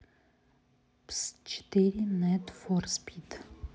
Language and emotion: Russian, neutral